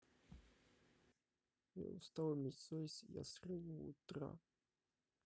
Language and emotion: Russian, sad